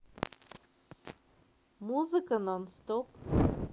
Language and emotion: Russian, neutral